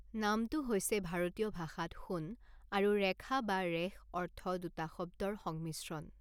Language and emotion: Assamese, neutral